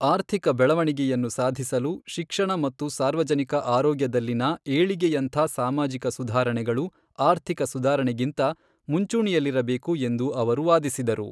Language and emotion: Kannada, neutral